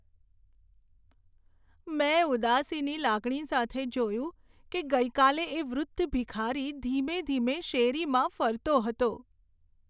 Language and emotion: Gujarati, sad